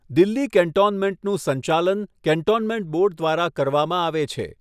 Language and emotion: Gujarati, neutral